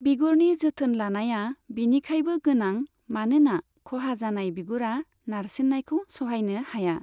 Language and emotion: Bodo, neutral